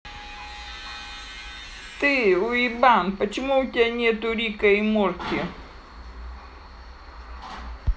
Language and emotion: Russian, angry